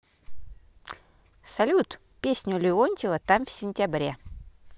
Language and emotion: Russian, positive